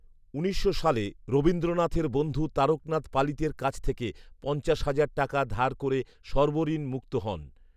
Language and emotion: Bengali, neutral